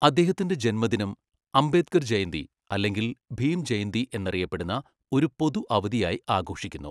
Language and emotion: Malayalam, neutral